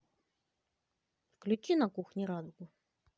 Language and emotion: Russian, positive